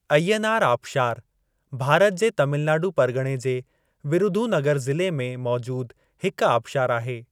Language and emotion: Sindhi, neutral